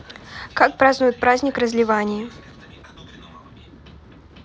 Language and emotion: Russian, neutral